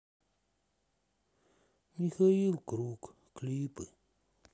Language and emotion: Russian, sad